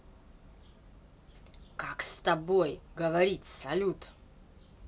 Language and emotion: Russian, angry